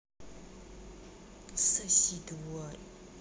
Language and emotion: Russian, angry